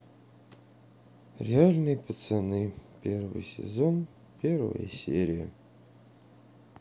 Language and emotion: Russian, sad